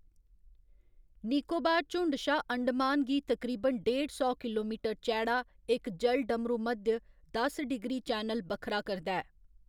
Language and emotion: Dogri, neutral